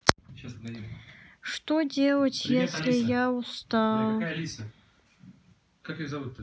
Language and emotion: Russian, sad